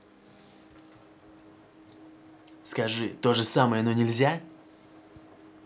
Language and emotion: Russian, angry